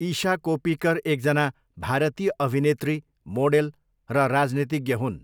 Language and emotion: Nepali, neutral